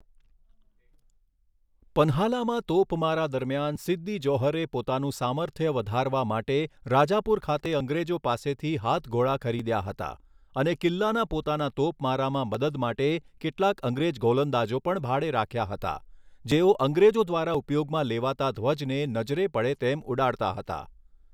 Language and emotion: Gujarati, neutral